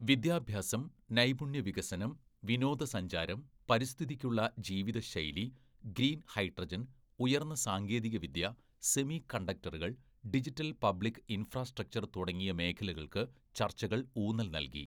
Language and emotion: Malayalam, neutral